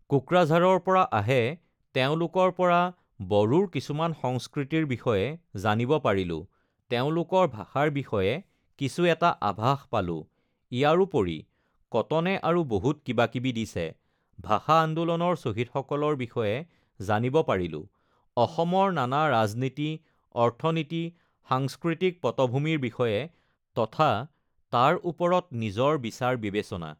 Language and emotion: Assamese, neutral